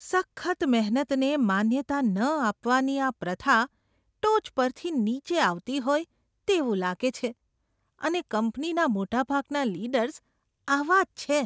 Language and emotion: Gujarati, disgusted